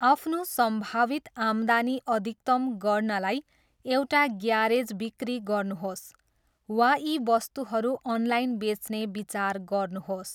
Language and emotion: Nepali, neutral